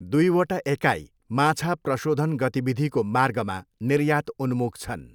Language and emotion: Nepali, neutral